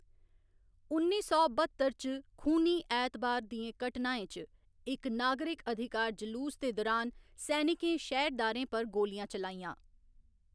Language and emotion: Dogri, neutral